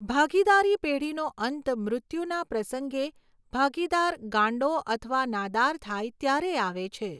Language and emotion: Gujarati, neutral